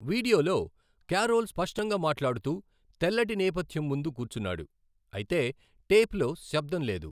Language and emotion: Telugu, neutral